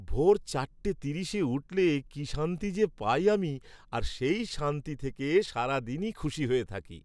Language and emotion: Bengali, happy